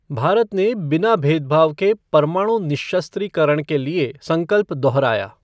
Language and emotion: Hindi, neutral